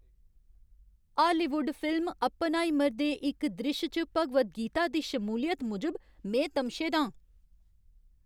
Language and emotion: Dogri, angry